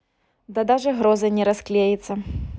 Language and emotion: Russian, neutral